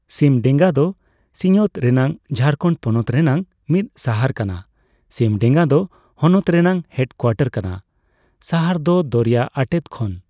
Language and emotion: Santali, neutral